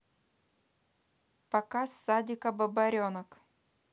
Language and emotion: Russian, neutral